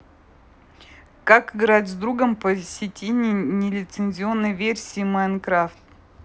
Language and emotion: Russian, neutral